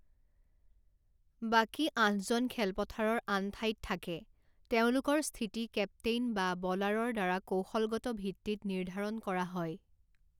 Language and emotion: Assamese, neutral